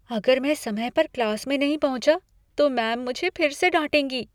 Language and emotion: Hindi, fearful